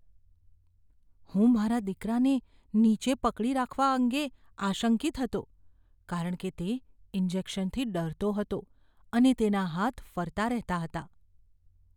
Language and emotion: Gujarati, fearful